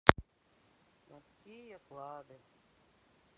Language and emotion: Russian, sad